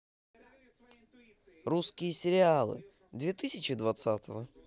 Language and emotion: Russian, positive